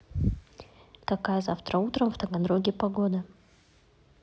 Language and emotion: Russian, neutral